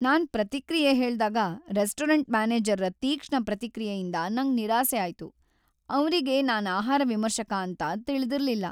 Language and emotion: Kannada, sad